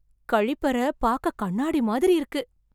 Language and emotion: Tamil, surprised